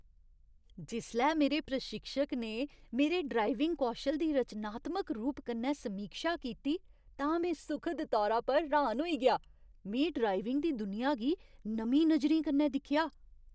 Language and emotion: Dogri, surprised